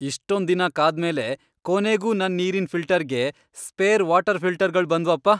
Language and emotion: Kannada, happy